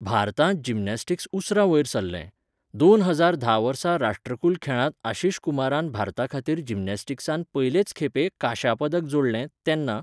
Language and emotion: Goan Konkani, neutral